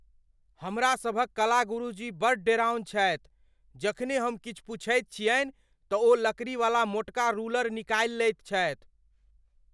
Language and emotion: Maithili, fearful